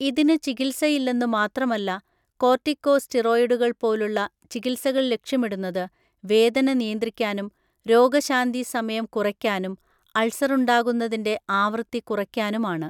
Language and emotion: Malayalam, neutral